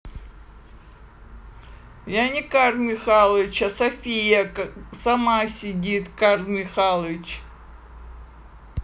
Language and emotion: Russian, neutral